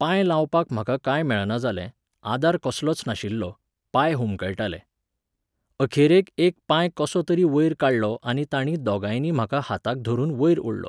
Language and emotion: Goan Konkani, neutral